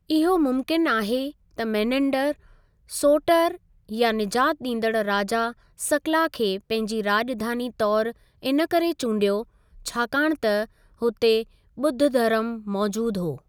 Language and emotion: Sindhi, neutral